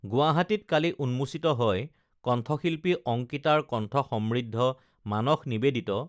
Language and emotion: Assamese, neutral